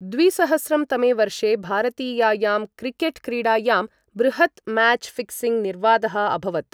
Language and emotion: Sanskrit, neutral